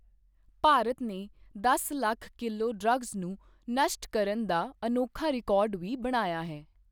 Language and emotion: Punjabi, neutral